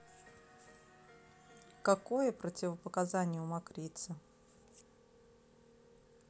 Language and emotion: Russian, neutral